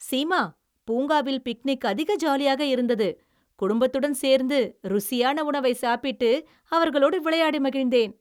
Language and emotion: Tamil, happy